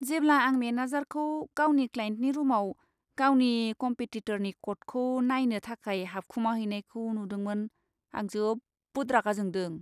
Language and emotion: Bodo, disgusted